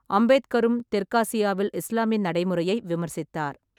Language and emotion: Tamil, neutral